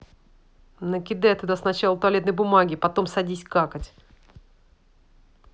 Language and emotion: Russian, angry